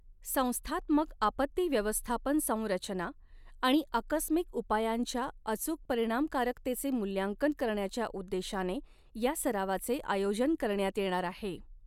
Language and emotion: Marathi, neutral